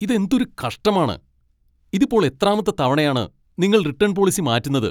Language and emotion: Malayalam, angry